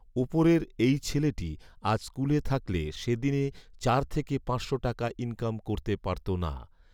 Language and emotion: Bengali, neutral